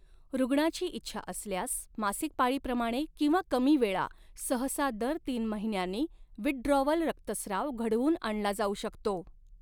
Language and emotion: Marathi, neutral